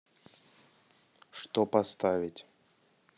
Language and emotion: Russian, neutral